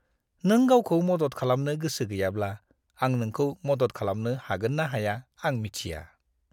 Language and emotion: Bodo, disgusted